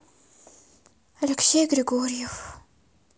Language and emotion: Russian, sad